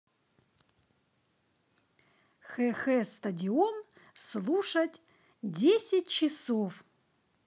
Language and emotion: Russian, positive